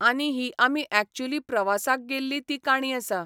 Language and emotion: Goan Konkani, neutral